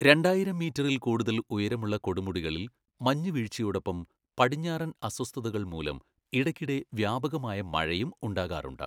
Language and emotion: Malayalam, neutral